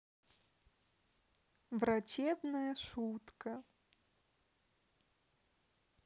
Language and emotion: Russian, neutral